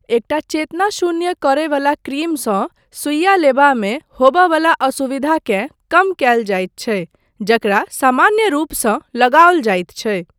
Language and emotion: Maithili, neutral